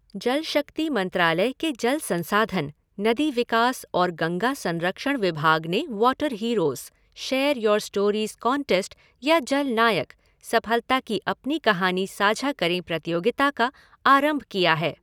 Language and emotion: Hindi, neutral